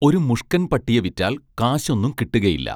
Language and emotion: Malayalam, neutral